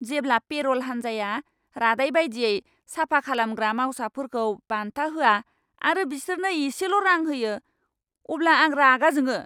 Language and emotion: Bodo, angry